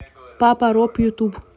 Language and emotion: Russian, neutral